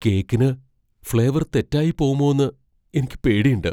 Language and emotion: Malayalam, fearful